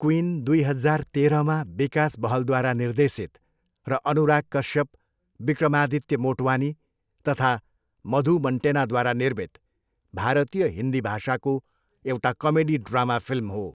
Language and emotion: Nepali, neutral